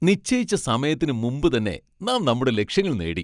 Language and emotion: Malayalam, happy